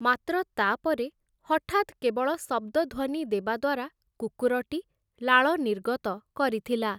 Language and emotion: Odia, neutral